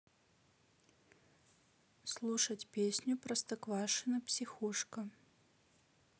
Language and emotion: Russian, neutral